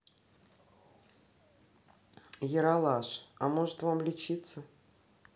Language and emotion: Russian, neutral